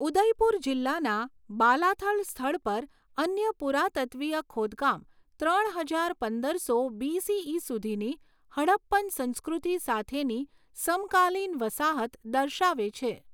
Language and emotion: Gujarati, neutral